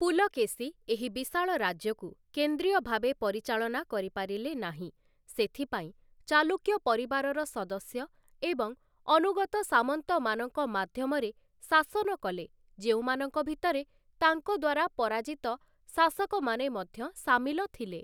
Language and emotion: Odia, neutral